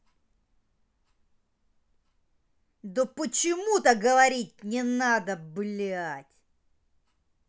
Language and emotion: Russian, angry